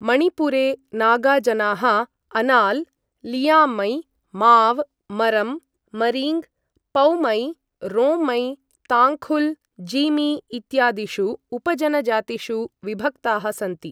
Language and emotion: Sanskrit, neutral